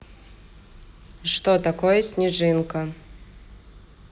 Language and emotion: Russian, neutral